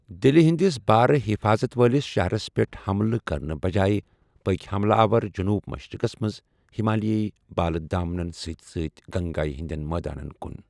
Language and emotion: Kashmiri, neutral